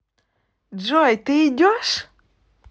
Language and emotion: Russian, positive